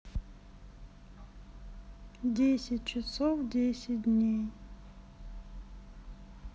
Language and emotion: Russian, sad